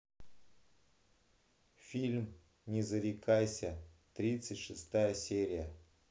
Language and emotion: Russian, neutral